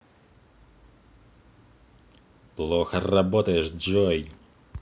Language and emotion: Russian, angry